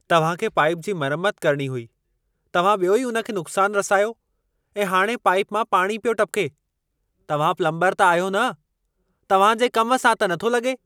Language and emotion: Sindhi, angry